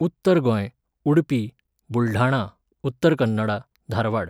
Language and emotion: Goan Konkani, neutral